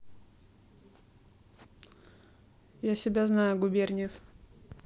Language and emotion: Russian, neutral